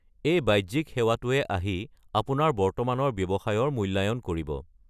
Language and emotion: Assamese, neutral